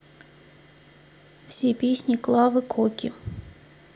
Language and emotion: Russian, neutral